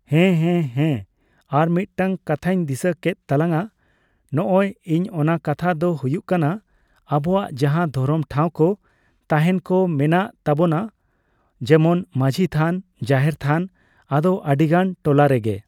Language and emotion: Santali, neutral